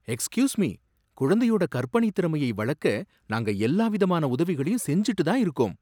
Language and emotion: Tamil, surprised